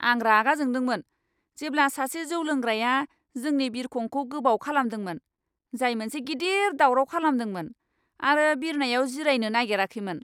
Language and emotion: Bodo, angry